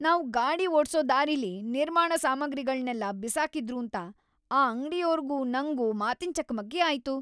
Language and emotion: Kannada, angry